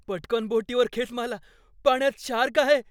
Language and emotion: Marathi, fearful